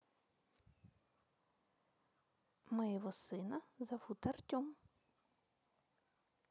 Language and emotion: Russian, neutral